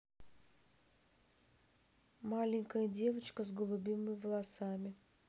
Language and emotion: Russian, neutral